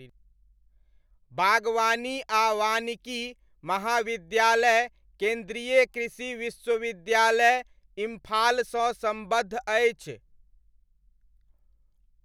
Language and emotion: Maithili, neutral